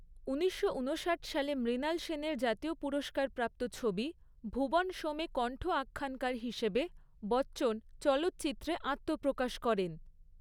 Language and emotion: Bengali, neutral